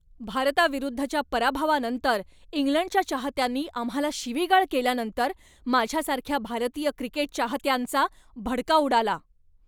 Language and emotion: Marathi, angry